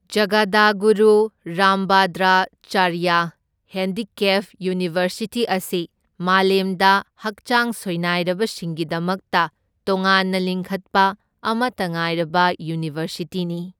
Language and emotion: Manipuri, neutral